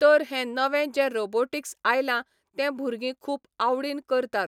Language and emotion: Goan Konkani, neutral